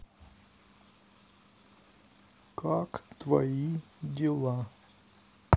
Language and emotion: Russian, sad